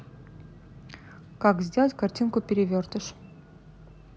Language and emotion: Russian, neutral